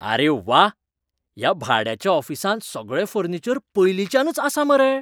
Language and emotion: Goan Konkani, surprised